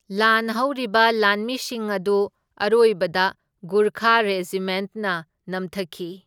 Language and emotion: Manipuri, neutral